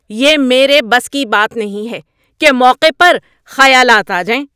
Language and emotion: Urdu, angry